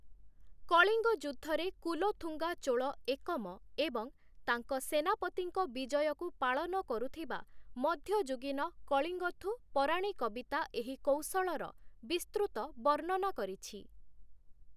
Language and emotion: Odia, neutral